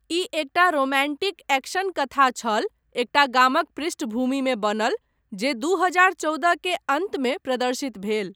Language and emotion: Maithili, neutral